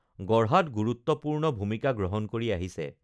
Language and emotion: Assamese, neutral